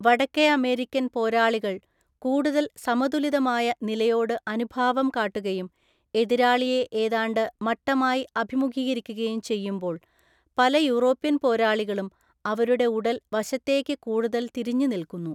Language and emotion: Malayalam, neutral